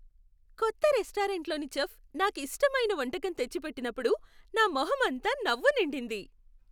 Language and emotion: Telugu, happy